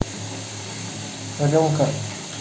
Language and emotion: Russian, neutral